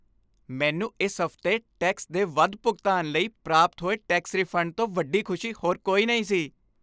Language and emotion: Punjabi, happy